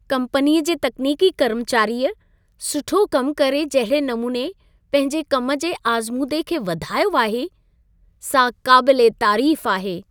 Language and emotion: Sindhi, happy